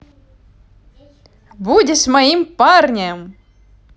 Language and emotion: Russian, positive